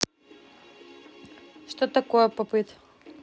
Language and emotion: Russian, neutral